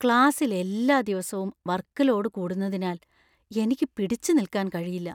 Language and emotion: Malayalam, fearful